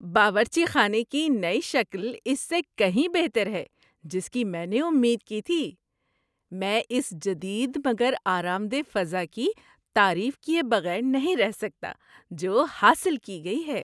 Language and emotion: Urdu, happy